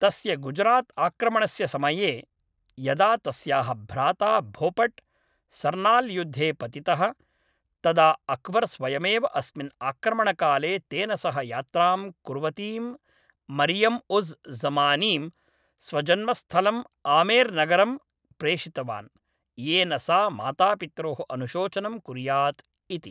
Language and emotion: Sanskrit, neutral